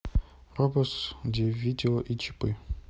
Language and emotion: Russian, neutral